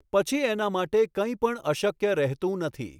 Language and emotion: Gujarati, neutral